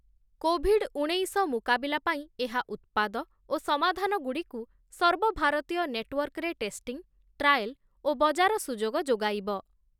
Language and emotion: Odia, neutral